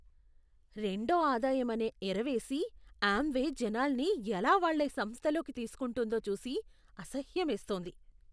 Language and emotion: Telugu, disgusted